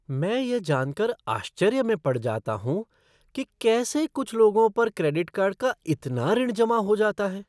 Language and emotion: Hindi, surprised